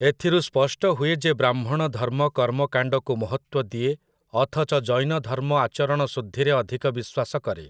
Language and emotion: Odia, neutral